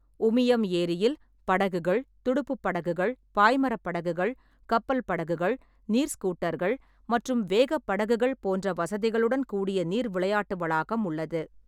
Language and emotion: Tamil, neutral